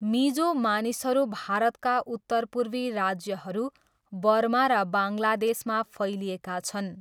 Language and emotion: Nepali, neutral